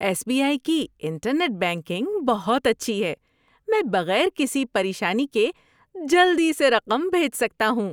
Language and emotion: Urdu, happy